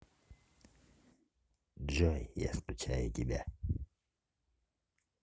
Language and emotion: Russian, neutral